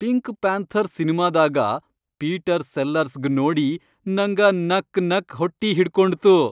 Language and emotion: Kannada, happy